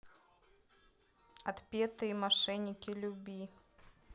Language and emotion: Russian, neutral